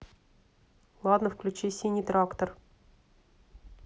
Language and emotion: Russian, neutral